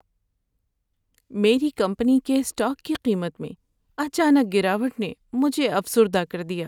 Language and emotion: Urdu, sad